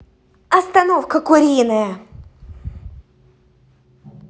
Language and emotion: Russian, angry